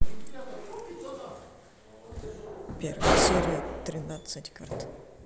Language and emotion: Russian, neutral